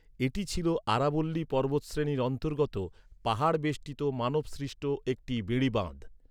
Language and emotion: Bengali, neutral